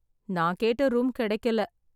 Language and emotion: Tamil, sad